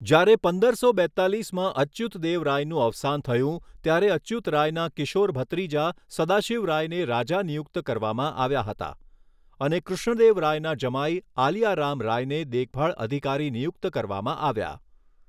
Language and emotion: Gujarati, neutral